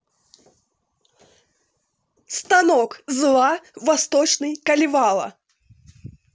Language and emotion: Russian, neutral